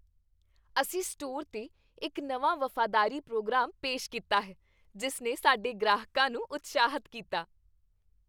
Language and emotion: Punjabi, happy